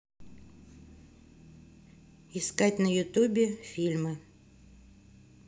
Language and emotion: Russian, neutral